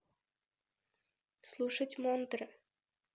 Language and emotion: Russian, neutral